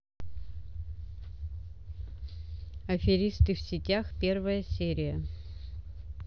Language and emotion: Russian, neutral